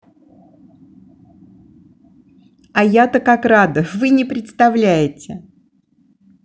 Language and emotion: Russian, positive